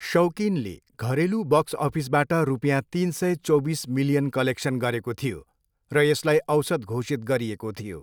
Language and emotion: Nepali, neutral